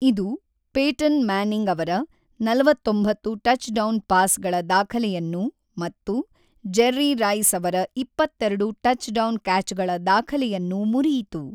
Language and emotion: Kannada, neutral